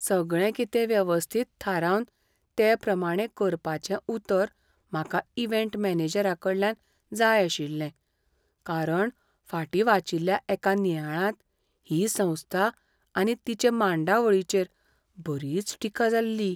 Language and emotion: Goan Konkani, fearful